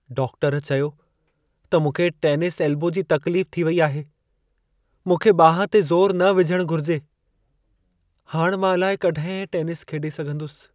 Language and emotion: Sindhi, sad